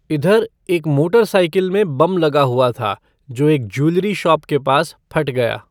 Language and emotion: Hindi, neutral